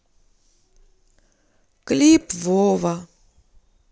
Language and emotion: Russian, sad